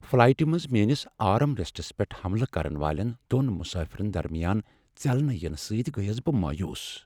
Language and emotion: Kashmiri, sad